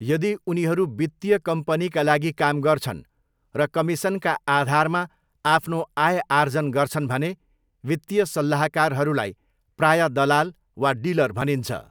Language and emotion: Nepali, neutral